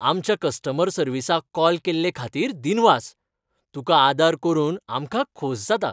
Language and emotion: Goan Konkani, happy